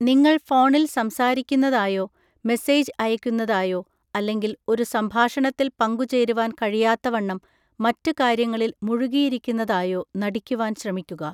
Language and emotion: Malayalam, neutral